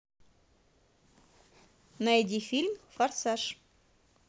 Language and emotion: Russian, positive